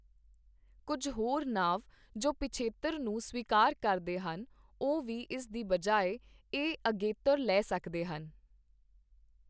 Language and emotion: Punjabi, neutral